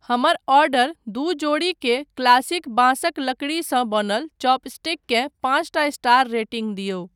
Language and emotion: Maithili, neutral